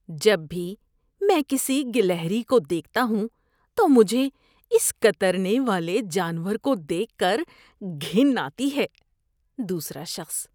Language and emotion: Urdu, disgusted